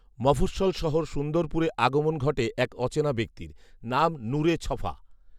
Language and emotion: Bengali, neutral